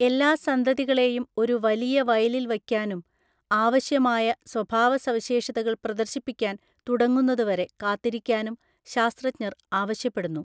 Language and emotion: Malayalam, neutral